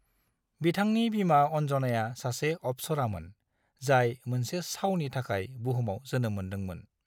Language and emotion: Bodo, neutral